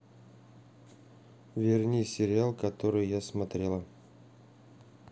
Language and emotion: Russian, neutral